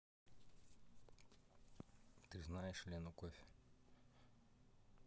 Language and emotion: Russian, neutral